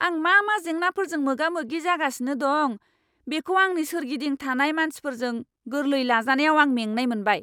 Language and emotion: Bodo, angry